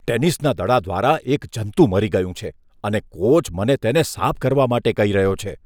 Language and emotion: Gujarati, disgusted